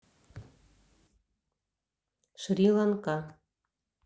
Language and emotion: Russian, neutral